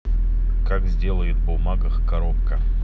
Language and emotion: Russian, neutral